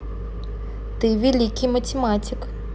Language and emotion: Russian, neutral